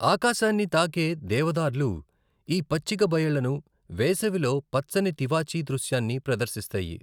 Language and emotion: Telugu, neutral